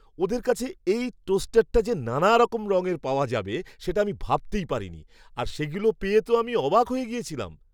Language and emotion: Bengali, surprised